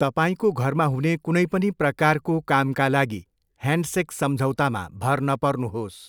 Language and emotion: Nepali, neutral